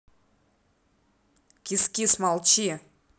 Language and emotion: Russian, angry